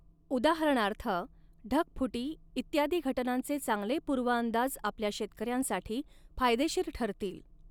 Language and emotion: Marathi, neutral